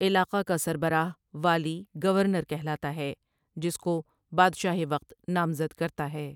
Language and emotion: Urdu, neutral